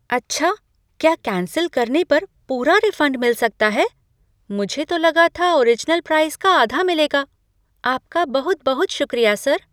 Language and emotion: Hindi, surprised